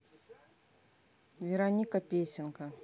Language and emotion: Russian, neutral